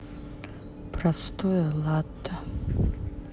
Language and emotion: Russian, sad